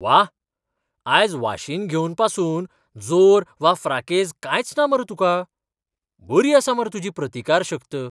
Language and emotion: Goan Konkani, surprised